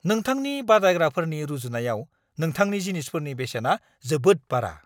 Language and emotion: Bodo, angry